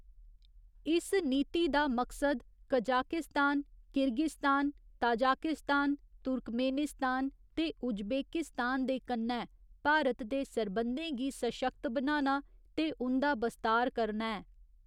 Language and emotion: Dogri, neutral